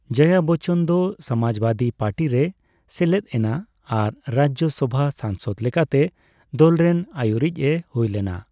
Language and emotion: Santali, neutral